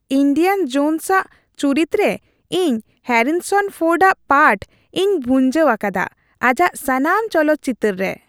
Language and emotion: Santali, happy